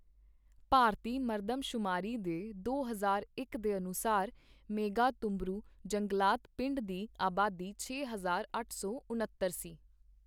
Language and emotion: Punjabi, neutral